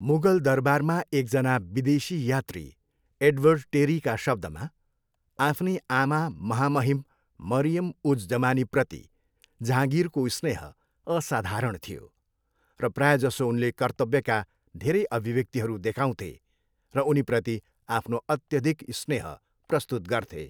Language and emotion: Nepali, neutral